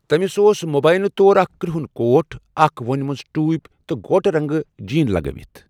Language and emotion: Kashmiri, neutral